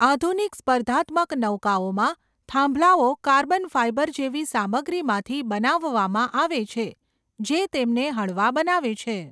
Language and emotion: Gujarati, neutral